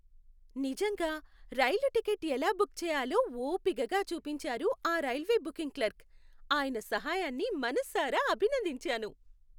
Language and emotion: Telugu, happy